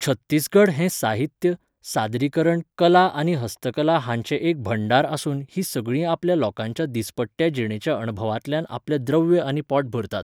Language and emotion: Goan Konkani, neutral